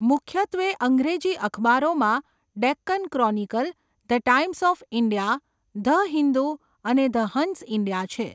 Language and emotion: Gujarati, neutral